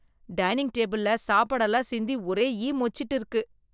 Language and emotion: Tamil, disgusted